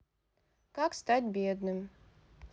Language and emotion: Russian, neutral